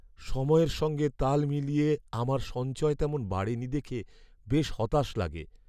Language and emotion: Bengali, sad